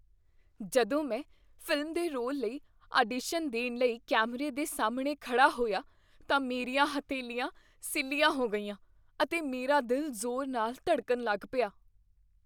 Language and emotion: Punjabi, fearful